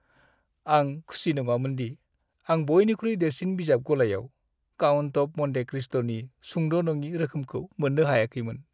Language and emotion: Bodo, sad